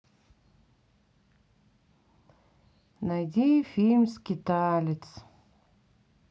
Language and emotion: Russian, sad